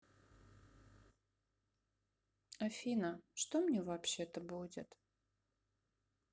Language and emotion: Russian, sad